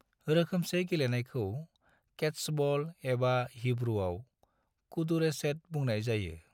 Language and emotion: Bodo, neutral